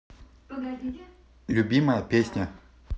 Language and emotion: Russian, neutral